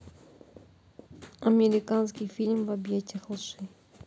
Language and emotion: Russian, neutral